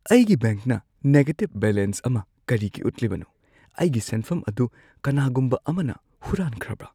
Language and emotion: Manipuri, fearful